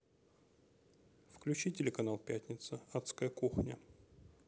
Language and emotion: Russian, neutral